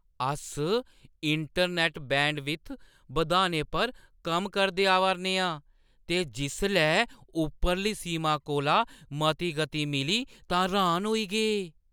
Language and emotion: Dogri, surprised